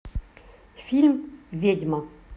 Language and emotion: Russian, neutral